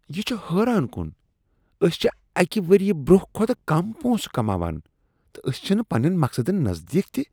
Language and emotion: Kashmiri, disgusted